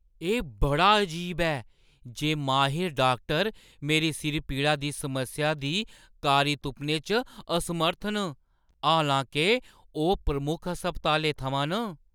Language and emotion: Dogri, surprised